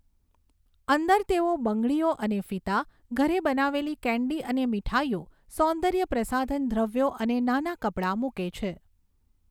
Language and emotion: Gujarati, neutral